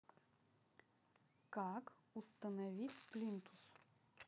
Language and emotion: Russian, neutral